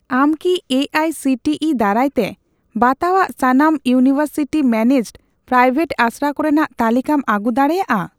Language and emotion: Santali, neutral